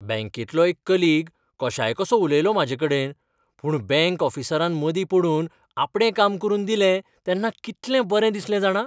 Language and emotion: Goan Konkani, happy